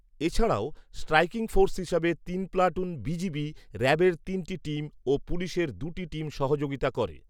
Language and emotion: Bengali, neutral